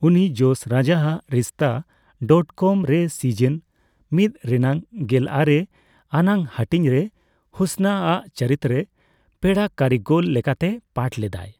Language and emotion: Santali, neutral